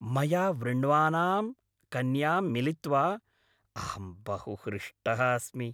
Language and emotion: Sanskrit, happy